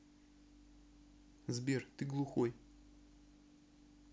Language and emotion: Russian, neutral